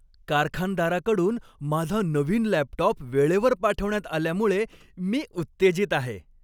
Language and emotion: Marathi, happy